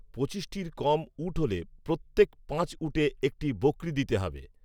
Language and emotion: Bengali, neutral